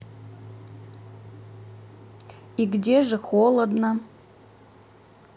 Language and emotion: Russian, neutral